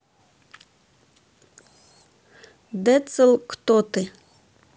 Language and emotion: Russian, neutral